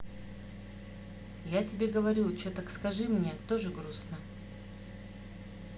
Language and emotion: Russian, sad